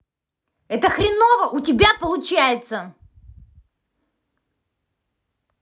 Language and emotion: Russian, angry